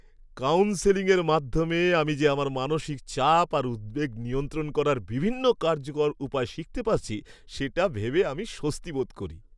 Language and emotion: Bengali, happy